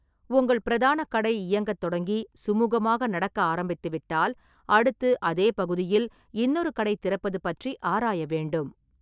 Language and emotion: Tamil, neutral